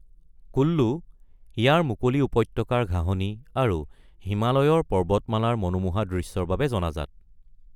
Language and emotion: Assamese, neutral